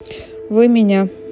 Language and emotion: Russian, neutral